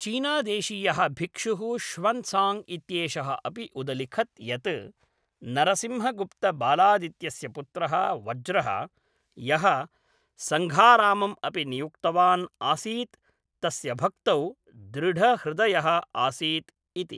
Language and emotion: Sanskrit, neutral